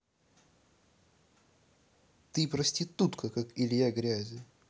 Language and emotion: Russian, angry